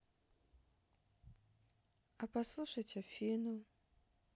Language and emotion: Russian, sad